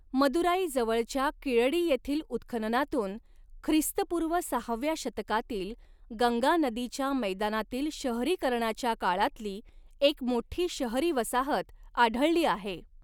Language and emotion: Marathi, neutral